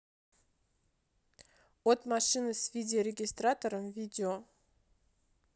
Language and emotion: Russian, neutral